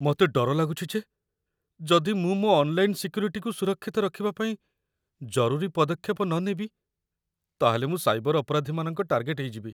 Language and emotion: Odia, fearful